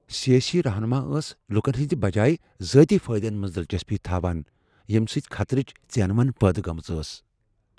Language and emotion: Kashmiri, fearful